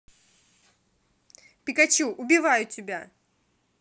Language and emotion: Russian, angry